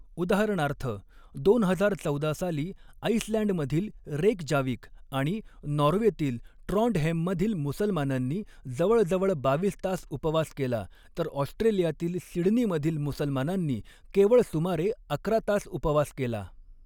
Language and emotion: Marathi, neutral